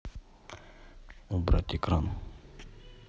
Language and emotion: Russian, neutral